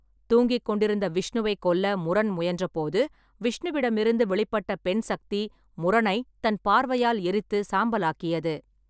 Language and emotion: Tamil, neutral